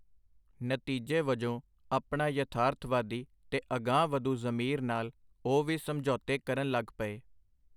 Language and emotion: Punjabi, neutral